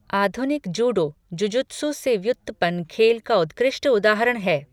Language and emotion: Hindi, neutral